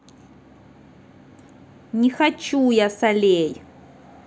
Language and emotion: Russian, angry